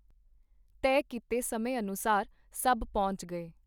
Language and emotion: Punjabi, neutral